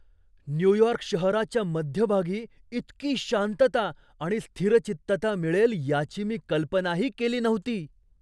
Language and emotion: Marathi, surprised